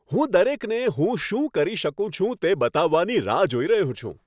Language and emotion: Gujarati, happy